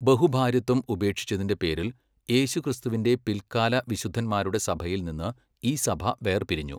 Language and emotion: Malayalam, neutral